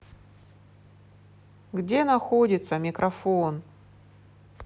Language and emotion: Russian, positive